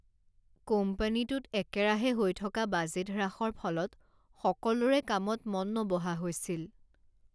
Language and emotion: Assamese, sad